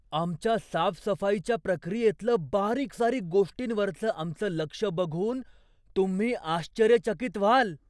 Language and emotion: Marathi, surprised